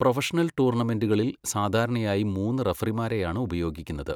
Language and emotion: Malayalam, neutral